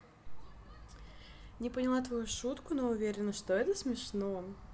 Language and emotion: Russian, positive